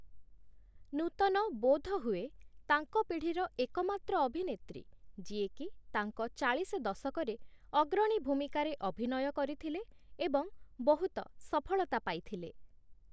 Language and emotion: Odia, neutral